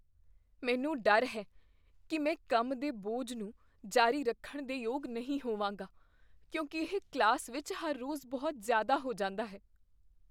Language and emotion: Punjabi, fearful